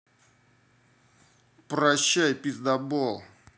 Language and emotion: Russian, angry